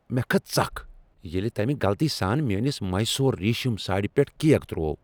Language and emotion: Kashmiri, angry